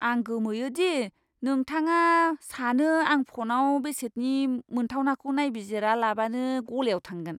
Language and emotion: Bodo, disgusted